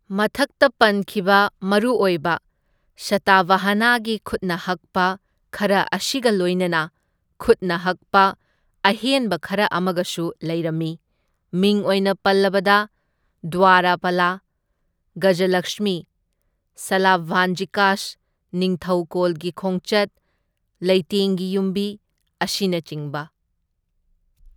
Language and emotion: Manipuri, neutral